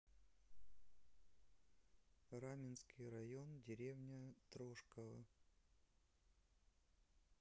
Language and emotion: Russian, neutral